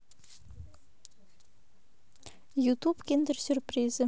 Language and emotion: Russian, neutral